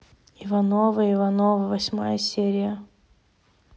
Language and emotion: Russian, neutral